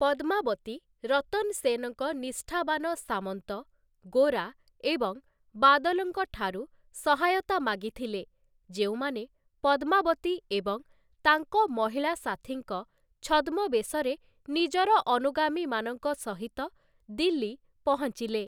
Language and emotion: Odia, neutral